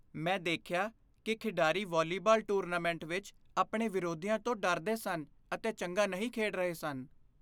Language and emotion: Punjabi, fearful